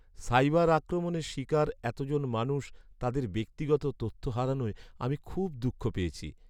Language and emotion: Bengali, sad